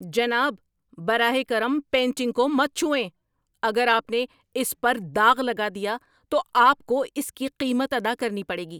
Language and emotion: Urdu, angry